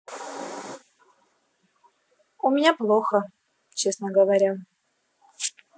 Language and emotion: Russian, neutral